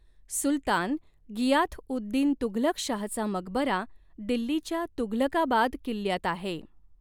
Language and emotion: Marathi, neutral